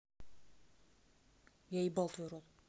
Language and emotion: Russian, neutral